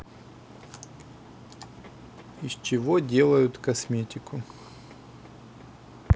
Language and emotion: Russian, neutral